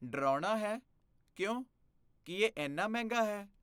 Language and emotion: Punjabi, fearful